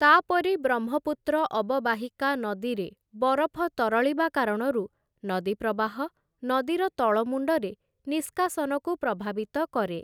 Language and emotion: Odia, neutral